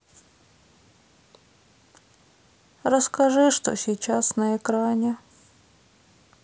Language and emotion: Russian, sad